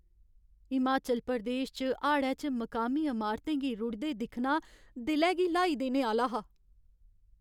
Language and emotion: Dogri, sad